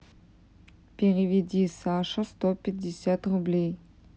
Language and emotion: Russian, neutral